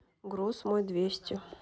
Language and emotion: Russian, neutral